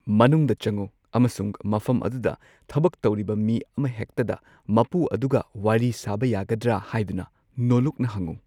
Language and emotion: Manipuri, neutral